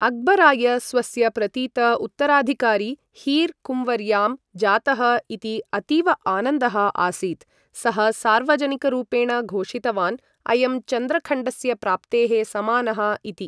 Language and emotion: Sanskrit, neutral